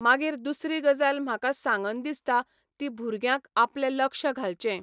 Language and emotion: Goan Konkani, neutral